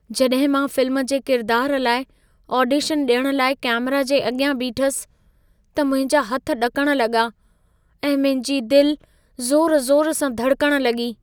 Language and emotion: Sindhi, fearful